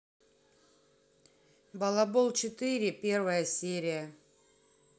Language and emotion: Russian, neutral